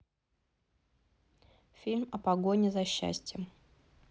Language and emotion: Russian, neutral